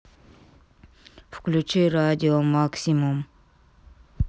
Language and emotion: Russian, neutral